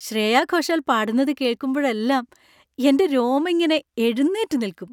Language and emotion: Malayalam, happy